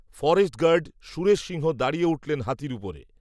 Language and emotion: Bengali, neutral